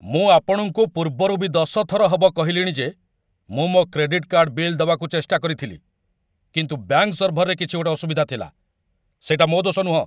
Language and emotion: Odia, angry